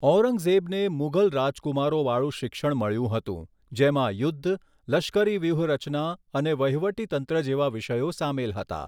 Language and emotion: Gujarati, neutral